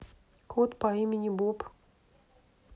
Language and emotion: Russian, neutral